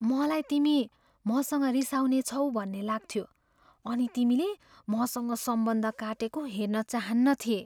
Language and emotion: Nepali, fearful